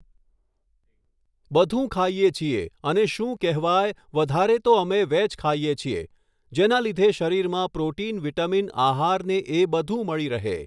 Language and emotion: Gujarati, neutral